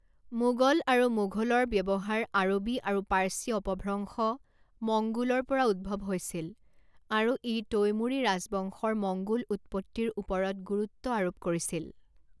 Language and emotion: Assamese, neutral